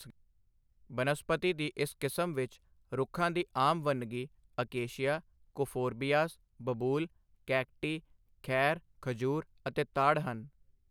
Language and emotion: Punjabi, neutral